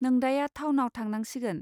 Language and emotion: Bodo, neutral